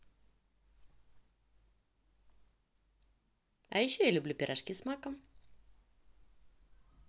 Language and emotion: Russian, positive